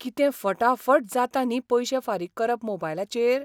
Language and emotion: Goan Konkani, surprised